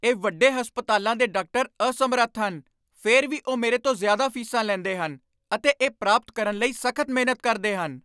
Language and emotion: Punjabi, angry